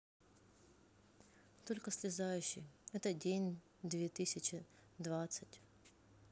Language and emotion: Russian, sad